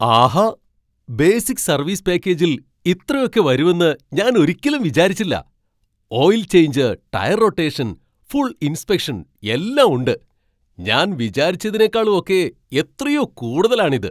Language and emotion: Malayalam, surprised